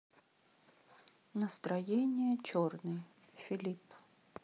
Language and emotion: Russian, sad